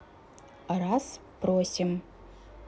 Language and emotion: Russian, neutral